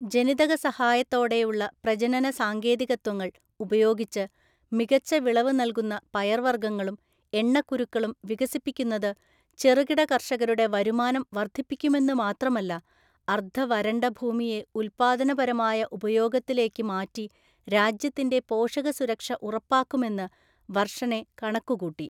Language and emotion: Malayalam, neutral